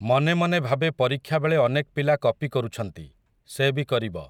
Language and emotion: Odia, neutral